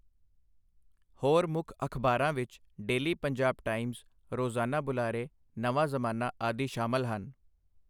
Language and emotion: Punjabi, neutral